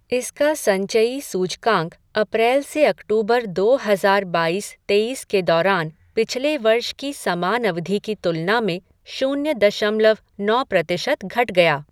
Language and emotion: Hindi, neutral